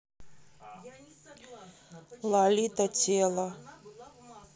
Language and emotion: Russian, neutral